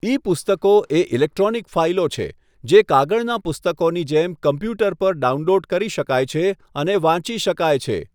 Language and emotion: Gujarati, neutral